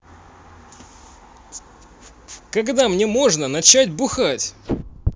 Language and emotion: Russian, angry